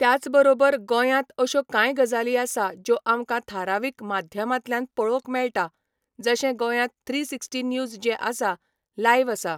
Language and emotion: Goan Konkani, neutral